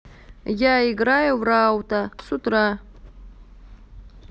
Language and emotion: Russian, neutral